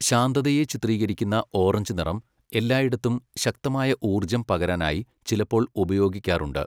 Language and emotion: Malayalam, neutral